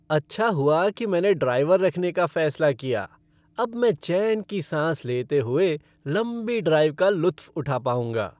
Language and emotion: Hindi, happy